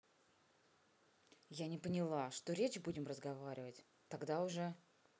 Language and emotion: Russian, angry